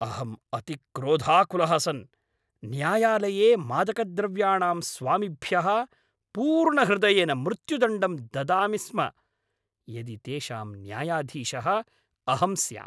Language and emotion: Sanskrit, angry